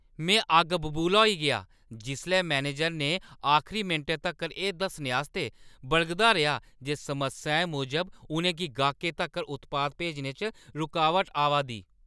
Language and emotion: Dogri, angry